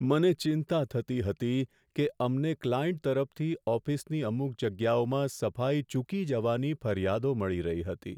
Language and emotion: Gujarati, sad